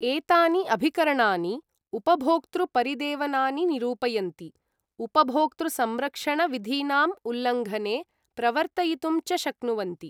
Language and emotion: Sanskrit, neutral